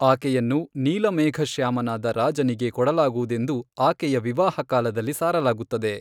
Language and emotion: Kannada, neutral